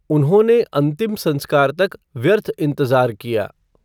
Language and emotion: Hindi, neutral